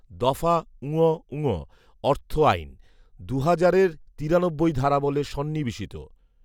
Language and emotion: Bengali, neutral